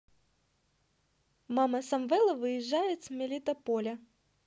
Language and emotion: Russian, positive